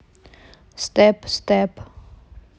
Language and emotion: Russian, neutral